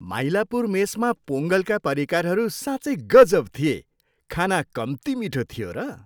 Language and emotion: Nepali, happy